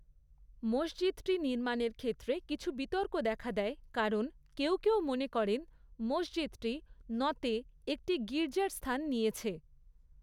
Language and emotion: Bengali, neutral